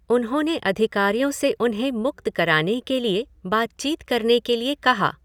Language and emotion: Hindi, neutral